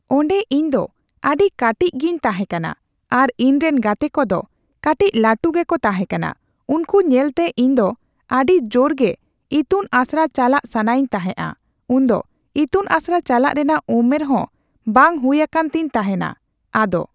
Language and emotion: Santali, neutral